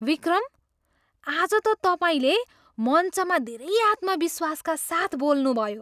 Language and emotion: Nepali, surprised